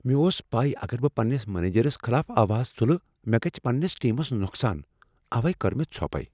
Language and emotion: Kashmiri, fearful